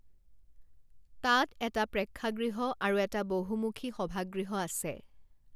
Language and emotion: Assamese, neutral